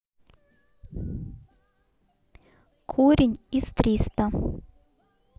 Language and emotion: Russian, neutral